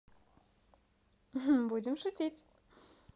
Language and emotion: Russian, positive